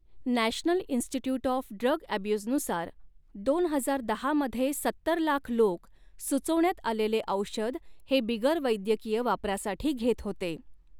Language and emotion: Marathi, neutral